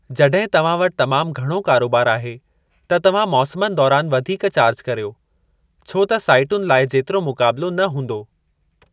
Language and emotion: Sindhi, neutral